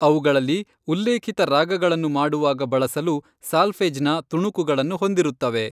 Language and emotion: Kannada, neutral